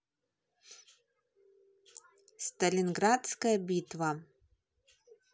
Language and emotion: Russian, neutral